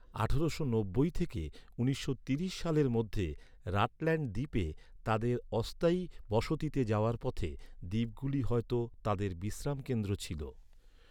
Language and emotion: Bengali, neutral